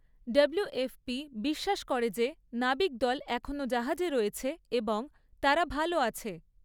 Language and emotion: Bengali, neutral